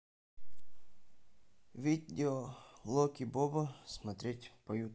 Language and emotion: Russian, neutral